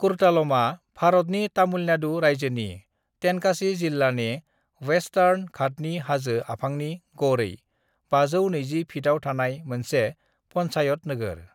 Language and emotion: Bodo, neutral